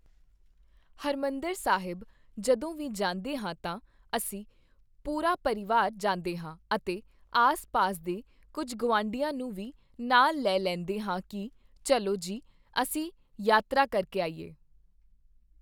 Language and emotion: Punjabi, neutral